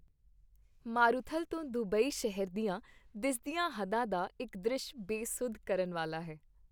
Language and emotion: Punjabi, happy